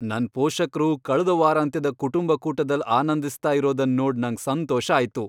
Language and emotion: Kannada, happy